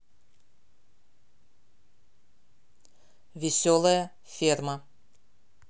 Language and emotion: Russian, neutral